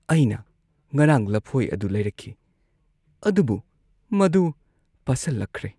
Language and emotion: Manipuri, sad